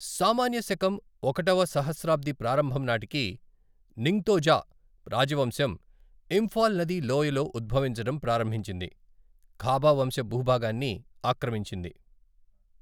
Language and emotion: Telugu, neutral